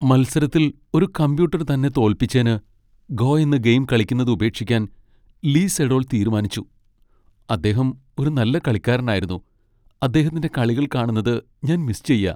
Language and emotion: Malayalam, sad